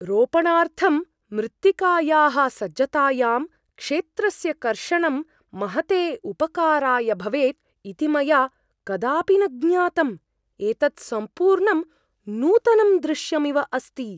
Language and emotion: Sanskrit, surprised